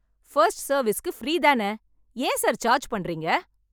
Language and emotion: Tamil, angry